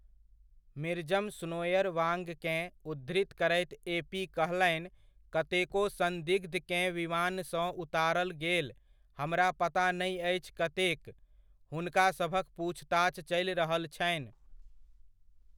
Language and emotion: Maithili, neutral